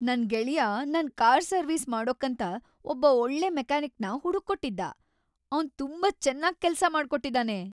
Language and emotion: Kannada, happy